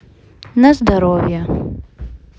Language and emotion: Russian, neutral